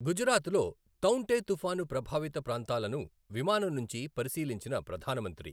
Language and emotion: Telugu, neutral